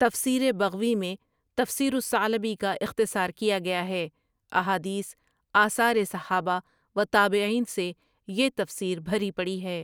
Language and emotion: Urdu, neutral